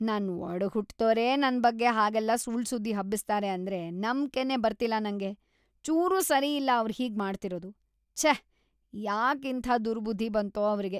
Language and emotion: Kannada, disgusted